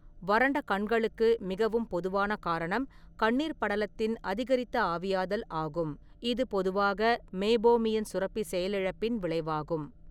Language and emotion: Tamil, neutral